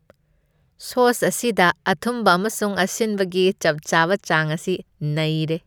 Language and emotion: Manipuri, happy